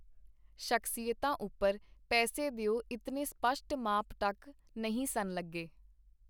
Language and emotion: Punjabi, neutral